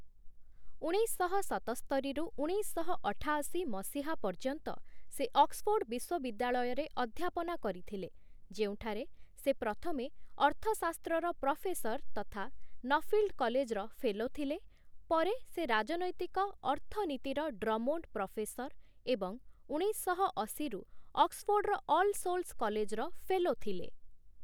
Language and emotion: Odia, neutral